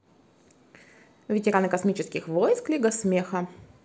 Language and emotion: Russian, positive